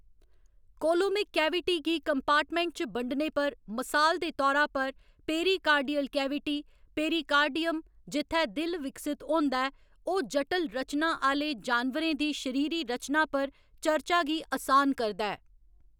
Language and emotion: Dogri, neutral